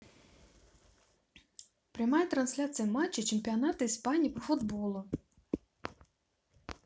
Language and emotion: Russian, positive